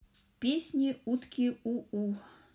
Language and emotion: Russian, neutral